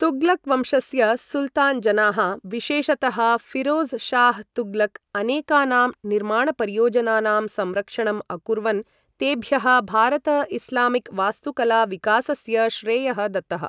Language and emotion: Sanskrit, neutral